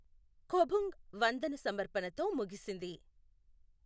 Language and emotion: Telugu, neutral